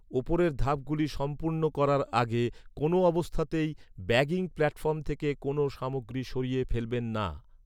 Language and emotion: Bengali, neutral